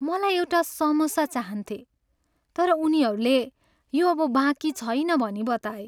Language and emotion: Nepali, sad